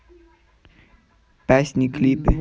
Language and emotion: Russian, neutral